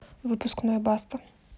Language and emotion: Russian, neutral